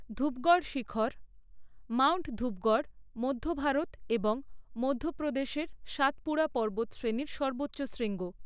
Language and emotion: Bengali, neutral